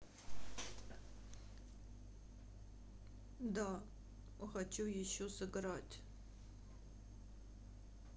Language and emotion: Russian, sad